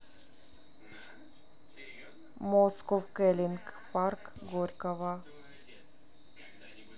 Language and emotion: Russian, neutral